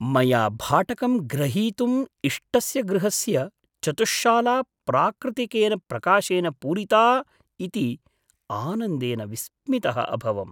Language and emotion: Sanskrit, surprised